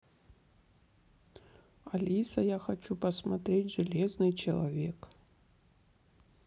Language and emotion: Russian, neutral